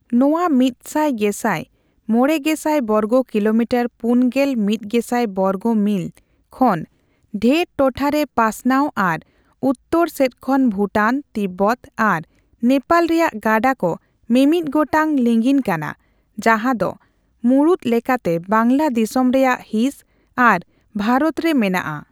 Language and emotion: Santali, neutral